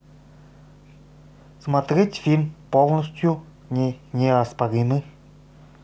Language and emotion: Russian, neutral